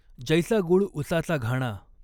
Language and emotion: Marathi, neutral